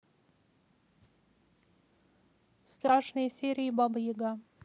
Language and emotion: Russian, neutral